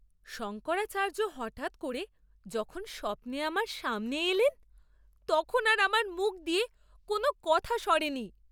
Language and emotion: Bengali, surprised